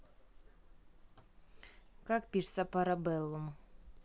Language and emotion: Russian, neutral